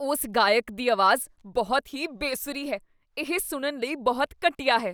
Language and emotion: Punjabi, disgusted